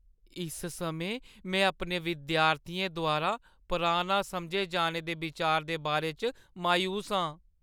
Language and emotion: Dogri, sad